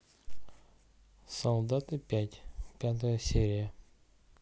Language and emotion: Russian, neutral